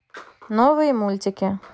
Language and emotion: Russian, neutral